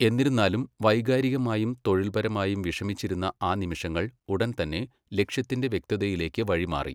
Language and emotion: Malayalam, neutral